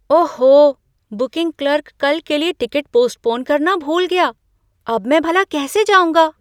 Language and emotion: Hindi, surprised